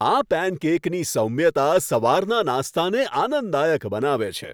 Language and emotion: Gujarati, happy